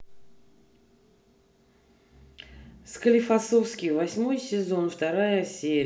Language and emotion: Russian, neutral